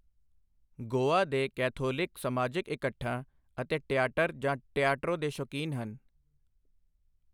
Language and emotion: Punjabi, neutral